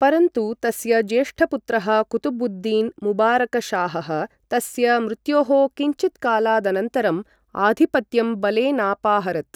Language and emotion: Sanskrit, neutral